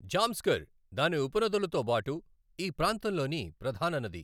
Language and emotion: Telugu, neutral